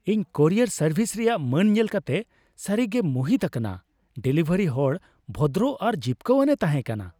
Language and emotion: Santali, happy